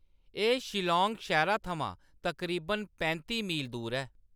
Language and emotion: Dogri, neutral